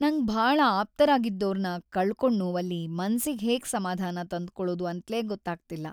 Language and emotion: Kannada, sad